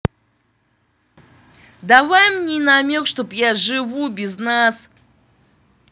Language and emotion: Russian, angry